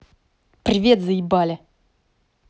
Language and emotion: Russian, angry